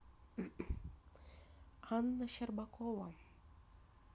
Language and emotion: Russian, neutral